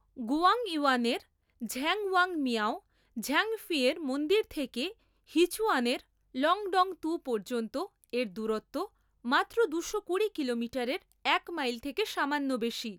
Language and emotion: Bengali, neutral